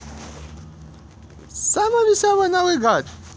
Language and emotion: Russian, positive